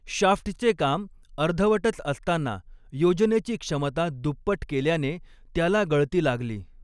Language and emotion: Marathi, neutral